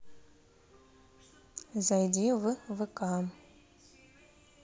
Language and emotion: Russian, neutral